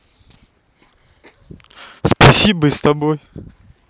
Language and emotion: Russian, neutral